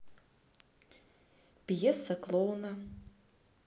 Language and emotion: Russian, neutral